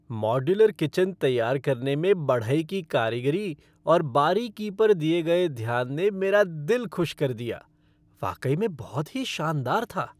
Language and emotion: Hindi, happy